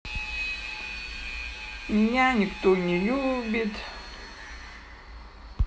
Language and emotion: Russian, sad